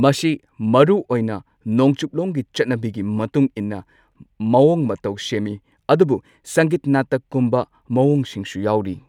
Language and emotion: Manipuri, neutral